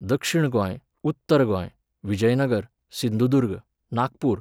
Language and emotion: Goan Konkani, neutral